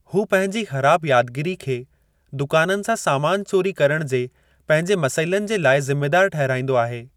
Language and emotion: Sindhi, neutral